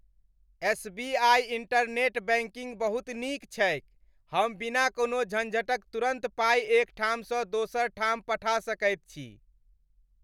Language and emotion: Maithili, happy